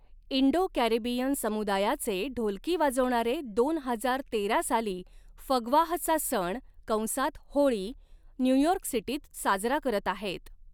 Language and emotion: Marathi, neutral